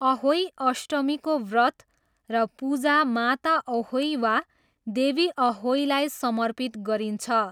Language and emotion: Nepali, neutral